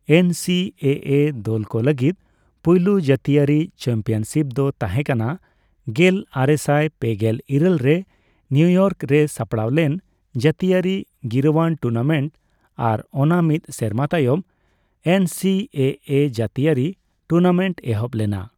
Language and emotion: Santali, neutral